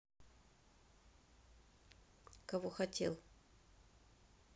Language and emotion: Russian, neutral